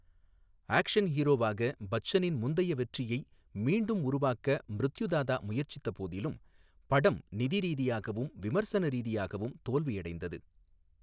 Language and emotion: Tamil, neutral